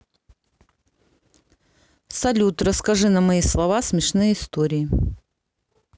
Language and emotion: Russian, neutral